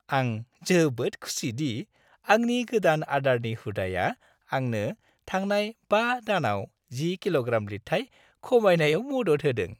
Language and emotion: Bodo, happy